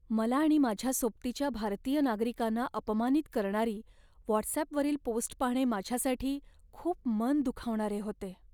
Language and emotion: Marathi, sad